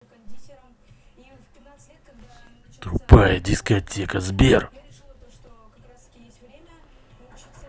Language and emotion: Russian, angry